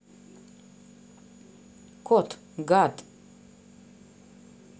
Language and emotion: Russian, neutral